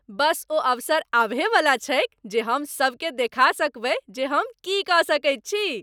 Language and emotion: Maithili, happy